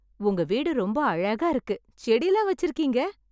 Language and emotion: Tamil, happy